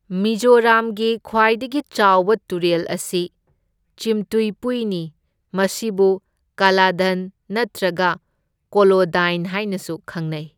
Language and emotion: Manipuri, neutral